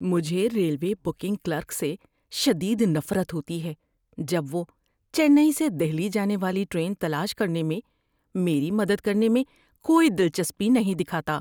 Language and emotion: Urdu, disgusted